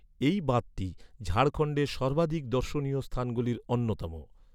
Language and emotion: Bengali, neutral